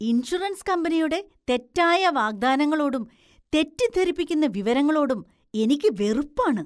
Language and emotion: Malayalam, disgusted